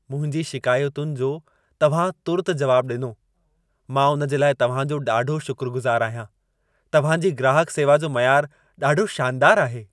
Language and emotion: Sindhi, happy